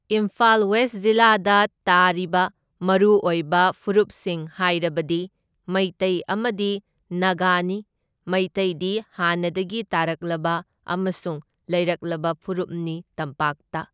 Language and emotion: Manipuri, neutral